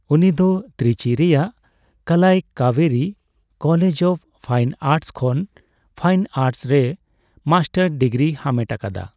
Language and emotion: Santali, neutral